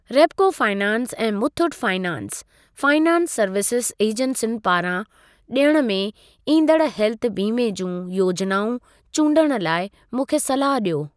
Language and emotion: Sindhi, neutral